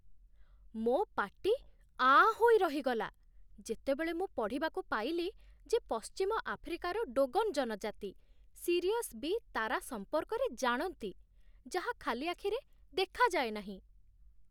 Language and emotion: Odia, surprised